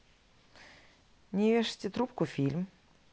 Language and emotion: Russian, neutral